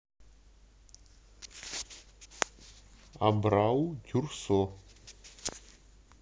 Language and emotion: Russian, neutral